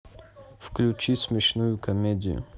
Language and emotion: Russian, neutral